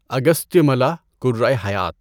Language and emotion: Urdu, neutral